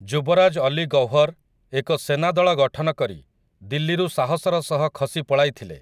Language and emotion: Odia, neutral